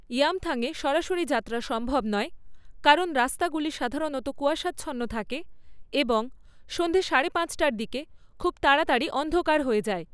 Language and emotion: Bengali, neutral